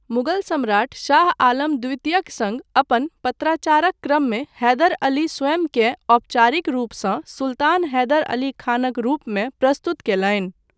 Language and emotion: Maithili, neutral